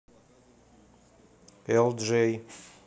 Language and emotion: Russian, neutral